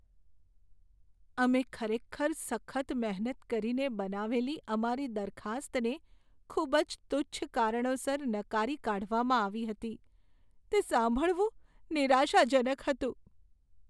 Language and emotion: Gujarati, sad